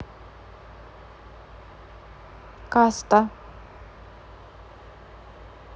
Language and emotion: Russian, neutral